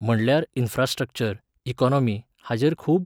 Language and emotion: Goan Konkani, neutral